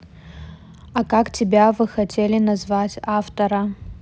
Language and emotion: Russian, neutral